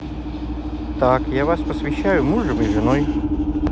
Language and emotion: Russian, neutral